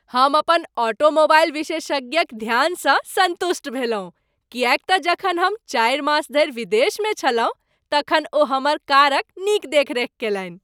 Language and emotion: Maithili, happy